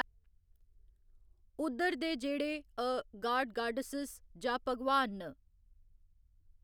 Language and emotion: Dogri, neutral